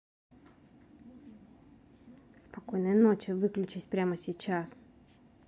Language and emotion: Russian, angry